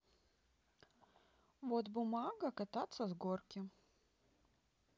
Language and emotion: Russian, neutral